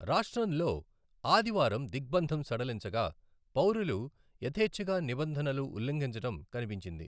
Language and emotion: Telugu, neutral